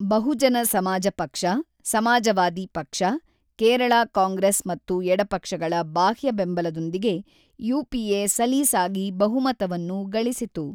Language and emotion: Kannada, neutral